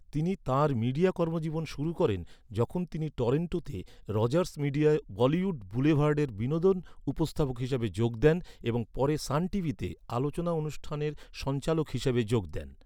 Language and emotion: Bengali, neutral